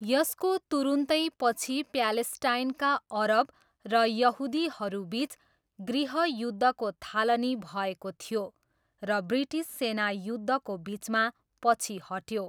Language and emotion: Nepali, neutral